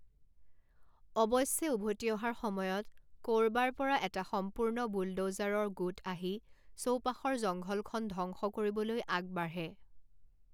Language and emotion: Assamese, neutral